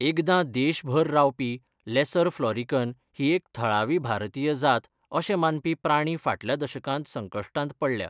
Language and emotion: Goan Konkani, neutral